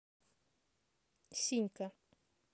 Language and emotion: Russian, neutral